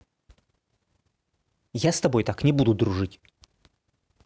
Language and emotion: Russian, angry